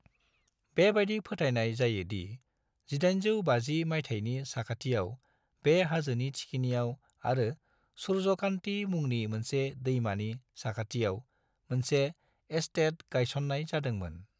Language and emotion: Bodo, neutral